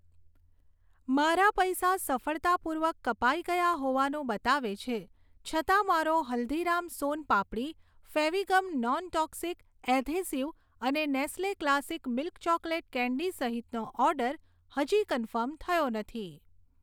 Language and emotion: Gujarati, neutral